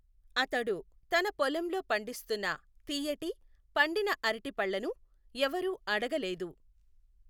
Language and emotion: Telugu, neutral